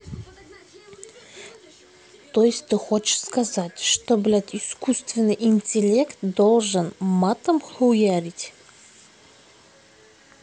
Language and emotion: Russian, angry